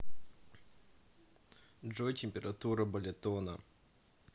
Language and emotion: Russian, neutral